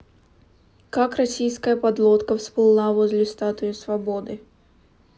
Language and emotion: Russian, neutral